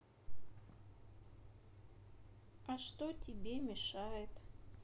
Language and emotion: Russian, sad